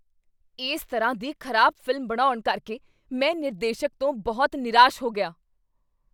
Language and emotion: Punjabi, angry